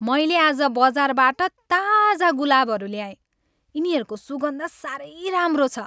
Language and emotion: Nepali, happy